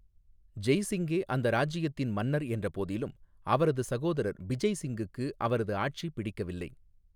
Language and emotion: Tamil, neutral